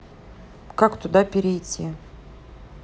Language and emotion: Russian, neutral